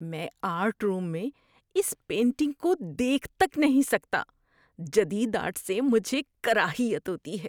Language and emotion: Urdu, disgusted